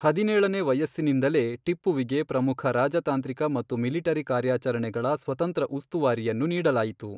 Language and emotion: Kannada, neutral